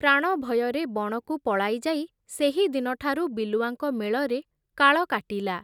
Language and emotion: Odia, neutral